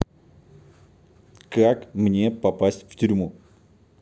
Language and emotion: Russian, neutral